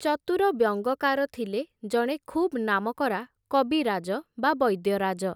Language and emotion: Odia, neutral